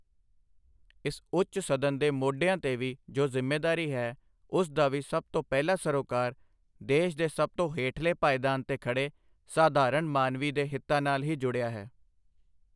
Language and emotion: Punjabi, neutral